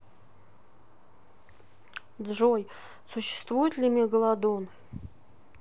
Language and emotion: Russian, neutral